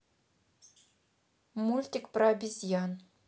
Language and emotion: Russian, neutral